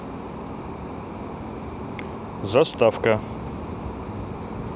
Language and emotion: Russian, neutral